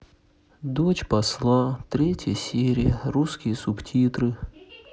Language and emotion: Russian, sad